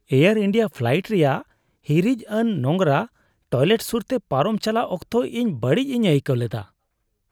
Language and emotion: Santali, disgusted